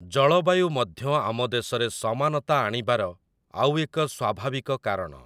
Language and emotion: Odia, neutral